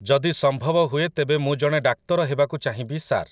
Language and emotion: Odia, neutral